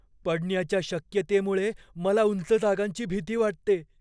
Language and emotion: Marathi, fearful